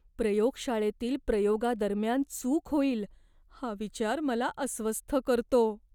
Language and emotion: Marathi, fearful